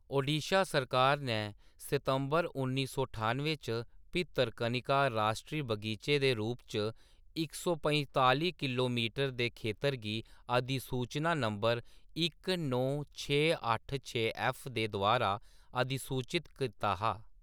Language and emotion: Dogri, neutral